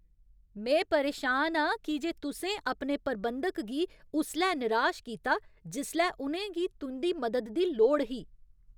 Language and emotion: Dogri, angry